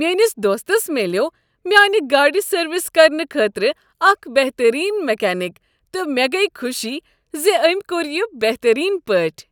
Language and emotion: Kashmiri, happy